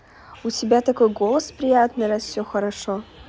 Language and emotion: Russian, positive